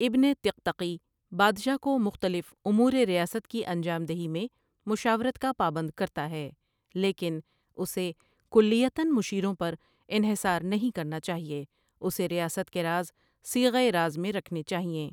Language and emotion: Urdu, neutral